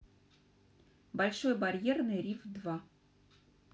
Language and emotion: Russian, neutral